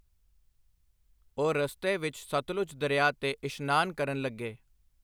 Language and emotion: Punjabi, neutral